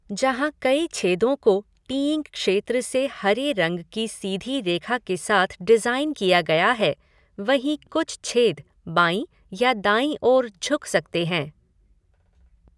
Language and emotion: Hindi, neutral